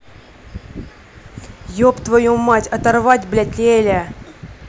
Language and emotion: Russian, angry